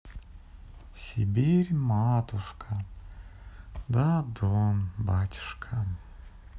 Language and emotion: Russian, neutral